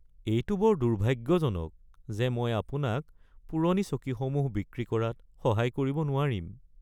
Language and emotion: Assamese, sad